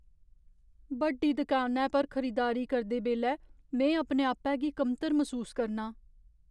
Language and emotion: Dogri, fearful